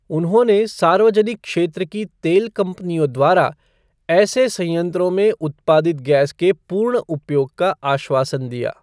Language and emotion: Hindi, neutral